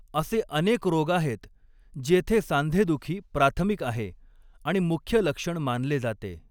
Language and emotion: Marathi, neutral